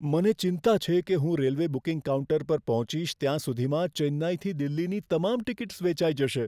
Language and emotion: Gujarati, fearful